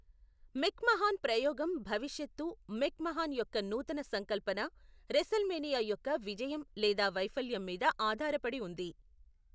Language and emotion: Telugu, neutral